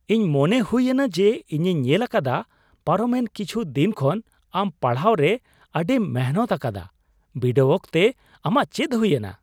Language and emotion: Santali, surprised